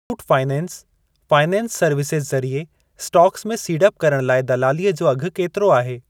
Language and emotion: Sindhi, neutral